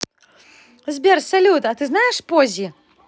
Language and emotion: Russian, positive